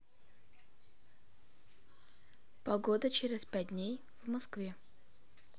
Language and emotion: Russian, neutral